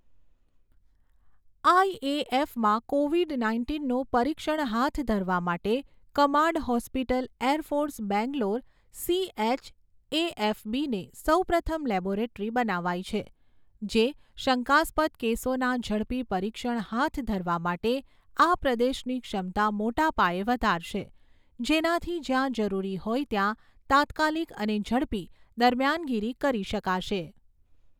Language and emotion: Gujarati, neutral